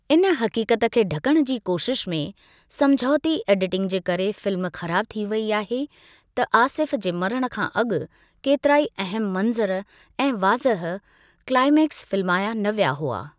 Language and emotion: Sindhi, neutral